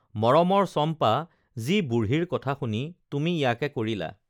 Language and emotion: Assamese, neutral